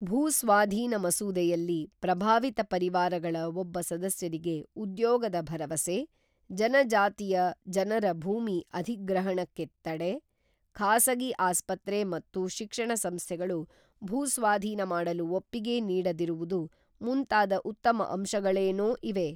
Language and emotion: Kannada, neutral